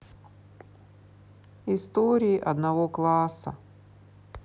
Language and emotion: Russian, sad